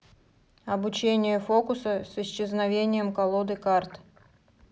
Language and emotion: Russian, neutral